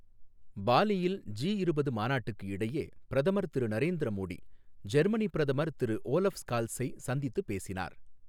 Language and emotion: Tamil, neutral